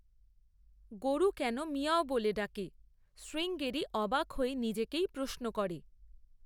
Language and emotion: Bengali, neutral